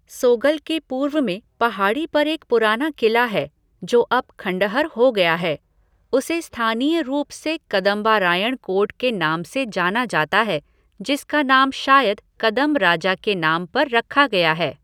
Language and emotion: Hindi, neutral